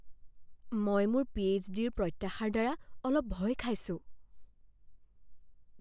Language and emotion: Assamese, fearful